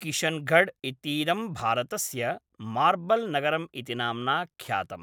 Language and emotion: Sanskrit, neutral